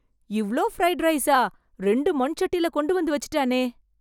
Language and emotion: Tamil, surprised